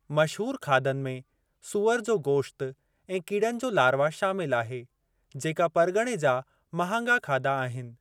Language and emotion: Sindhi, neutral